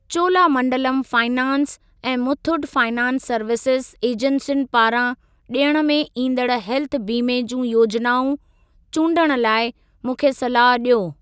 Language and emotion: Sindhi, neutral